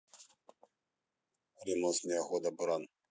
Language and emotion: Russian, neutral